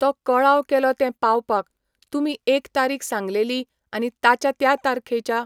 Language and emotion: Goan Konkani, neutral